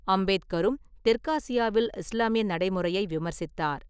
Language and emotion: Tamil, neutral